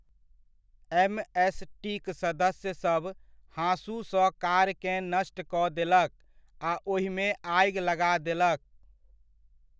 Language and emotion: Maithili, neutral